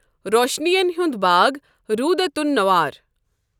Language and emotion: Kashmiri, neutral